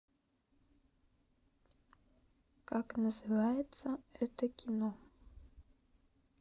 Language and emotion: Russian, neutral